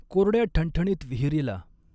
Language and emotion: Marathi, neutral